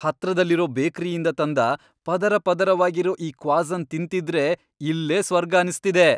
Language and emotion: Kannada, happy